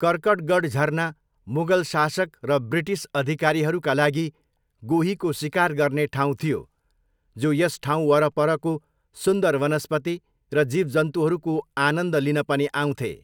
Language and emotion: Nepali, neutral